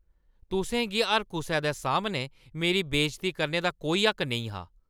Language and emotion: Dogri, angry